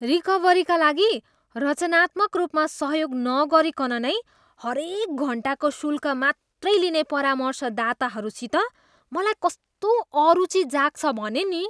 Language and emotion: Nepali, disgusted